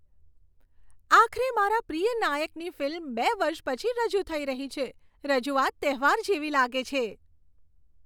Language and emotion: Gujarati, happy